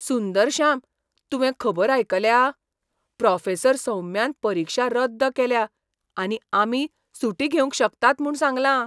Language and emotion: Goan Konkani, surprised